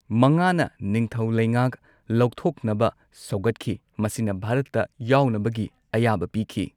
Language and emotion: Manipuri, neutral